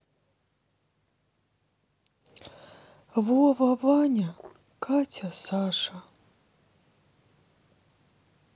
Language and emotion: Russian, sad